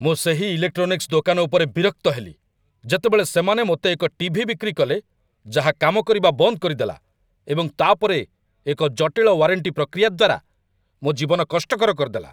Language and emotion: Odia, angry